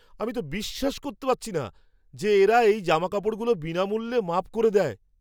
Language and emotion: Bengali, surprised